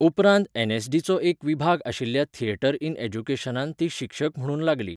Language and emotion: Goan Konkani, neutral